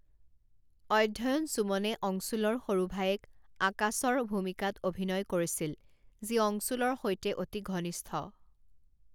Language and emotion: Assamese, neutral